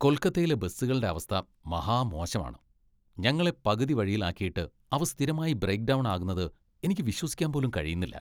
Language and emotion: Malayalam, disgusted